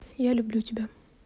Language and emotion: Russian, neutral